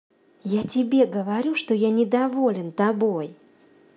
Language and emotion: Russian, angry